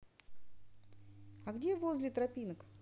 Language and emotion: Russian, neutral